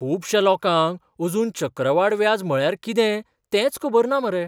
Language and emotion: Goan Konkani, surprised